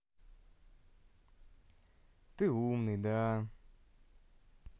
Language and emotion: Russian, positive